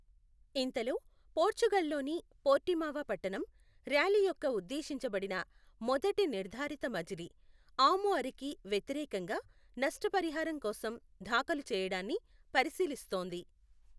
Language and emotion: Telugu, neutral